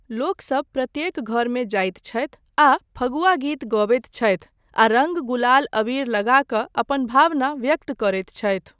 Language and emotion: Maithili, neutral